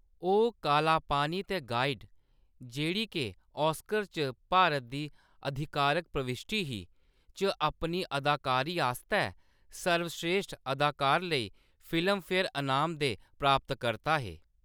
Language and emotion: Dogri, neutral